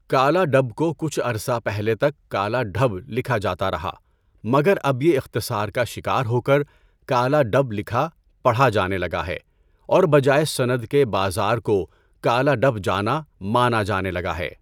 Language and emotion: Urdu, neutral